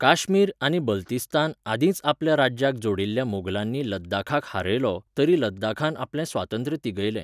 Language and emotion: Goan Konkani, neutral